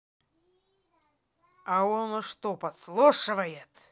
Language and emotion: Russian, angry